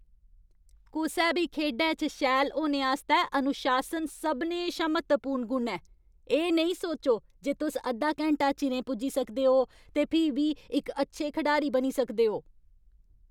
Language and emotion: Dogri, angry